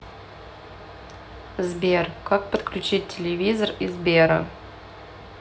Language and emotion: Russian, neutral